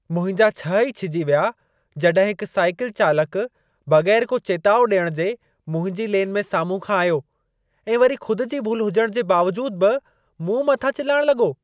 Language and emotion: Sindhi, angry